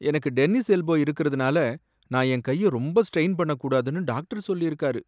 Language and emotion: Tamil, sad